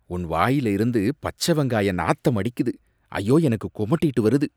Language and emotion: Tamil, disgusted